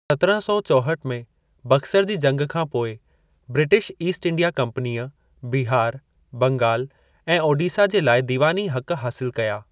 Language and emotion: Sindhi, neutral